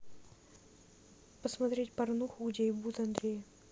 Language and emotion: Russian, neutral